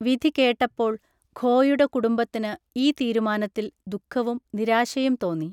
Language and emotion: Malayalam, neutral